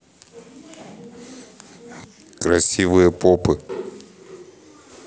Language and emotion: Russian, neutral